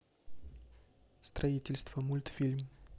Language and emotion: Russian, neutral